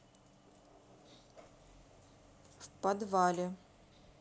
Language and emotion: Russian, neutral